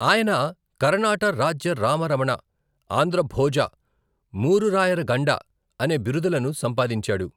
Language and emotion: Telugu, neutral